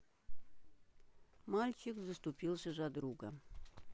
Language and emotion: Russian, neutral